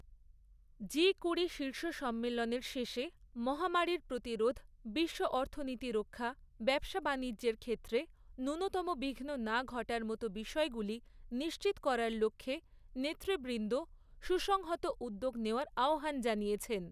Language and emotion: Bengali, neutral